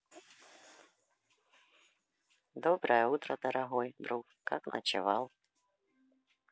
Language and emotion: Russian, neutral